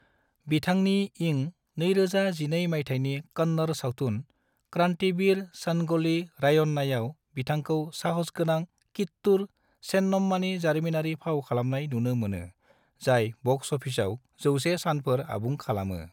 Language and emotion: Bodo, neutral